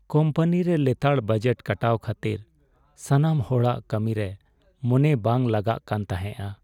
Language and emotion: Santali, sad